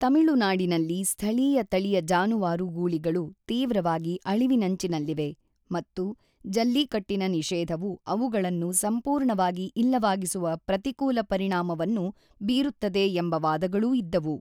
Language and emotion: Kannada, neutral